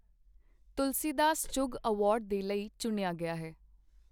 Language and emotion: Punjabi, neutral